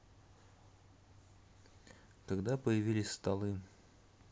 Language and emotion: Russian, neutral